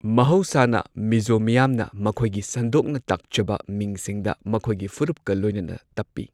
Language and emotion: Manipuri, neutral